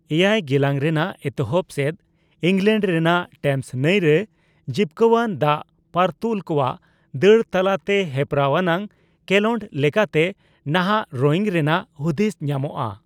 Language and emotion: Santali, neutral